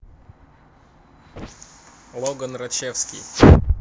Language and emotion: Russian, neutral